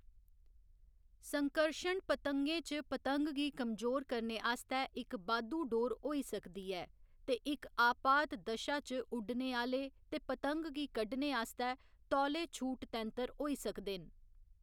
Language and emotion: Dogri, neutral